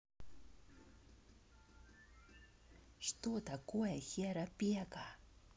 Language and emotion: Russian, neutral